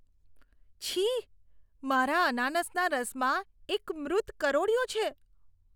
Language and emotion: Gujarati, disgusted